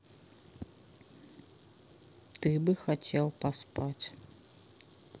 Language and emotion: Russian, sad